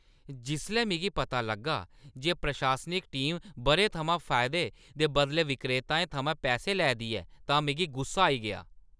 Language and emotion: Dogri, angry